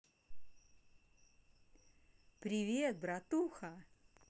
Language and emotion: Russian, positive